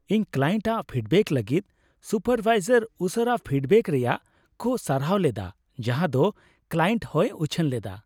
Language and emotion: Santali, happy